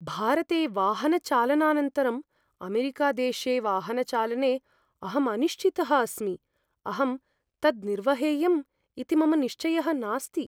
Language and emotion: Sanskrit, fearful